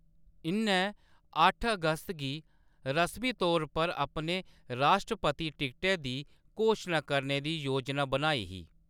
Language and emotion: Dogri, neutral